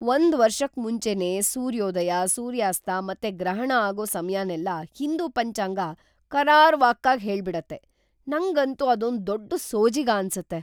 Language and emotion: Kannada, surprised